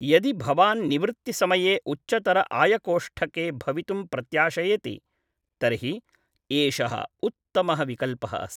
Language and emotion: Sanskrit, neutral